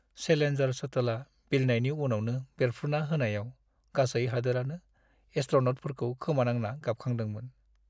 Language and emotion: Bodo, sad